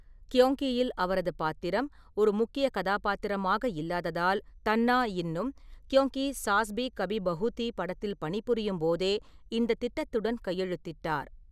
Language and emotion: Tamil, neutral